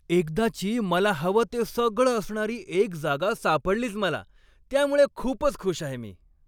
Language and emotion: Marathi, happy